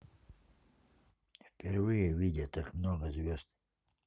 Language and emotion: Russian, neutral